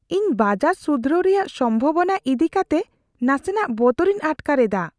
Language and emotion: Santali, fearful